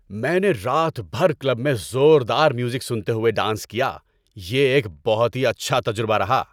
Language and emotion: Urdu, happy